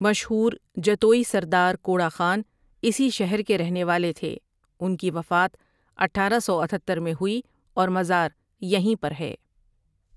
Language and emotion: Urdu, neutral